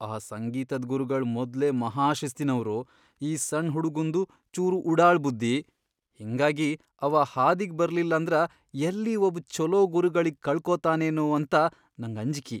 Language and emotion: Kannada, fearful